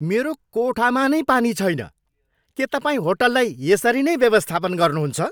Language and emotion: Nepali, angry